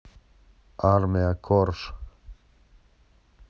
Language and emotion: Russian, neutral